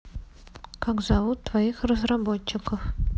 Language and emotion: Russian, neutral